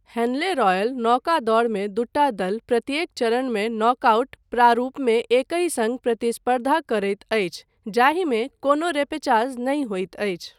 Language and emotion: Maithili, neutral